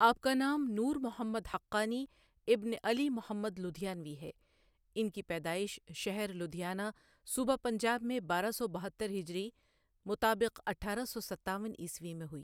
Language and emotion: Urdu, neutral